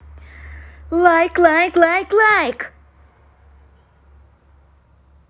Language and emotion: Russian, positive